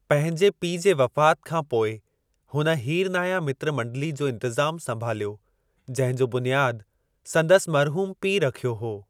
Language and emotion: Sindhi, neutral